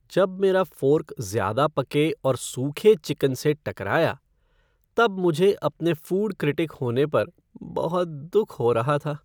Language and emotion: Hindi, sad